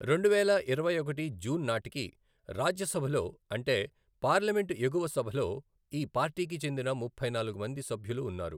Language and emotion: Telugu, neutral